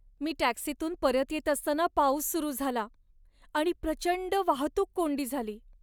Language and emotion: Marathi, sad